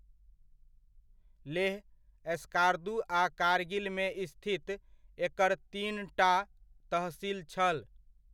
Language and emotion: Maithili, neutral